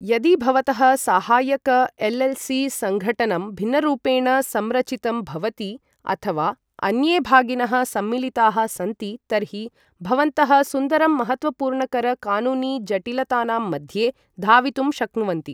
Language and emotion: Sanskrit, neutral